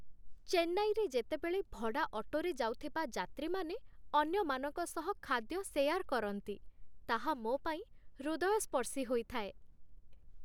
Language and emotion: Odia, happy